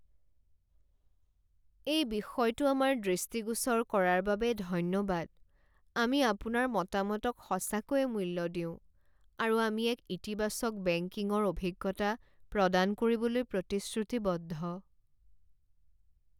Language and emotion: Assamese, sad